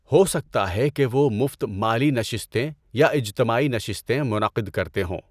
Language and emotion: Urdu, neutral